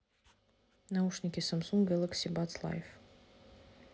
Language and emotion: Russian, neutral